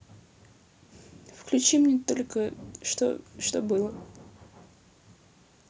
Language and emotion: Russian, sad